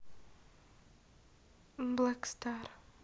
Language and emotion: Russian, neutral